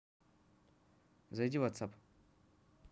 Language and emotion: Russian, neutral